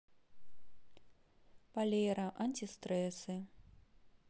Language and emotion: Russian, neutral